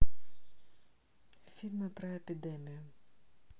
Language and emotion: Russian, neutral